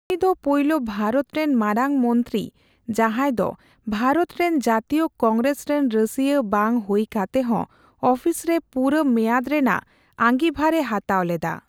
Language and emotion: Santali, neutral